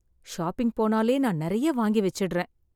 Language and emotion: Tamil, sad